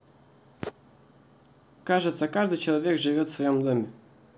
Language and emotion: Russian, neutral